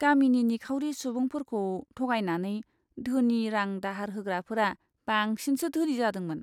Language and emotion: Bodo, disgusted